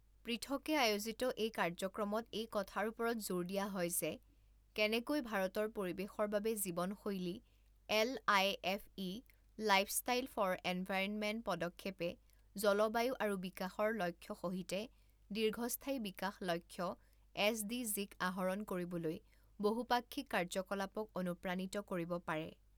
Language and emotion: Assamese, neutral